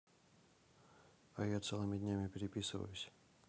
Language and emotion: Russian, neutral